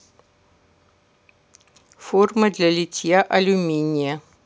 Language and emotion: Russian, neutral